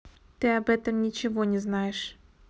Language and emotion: Russian, neutral